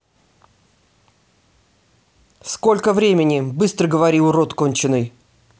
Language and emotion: Russian, angry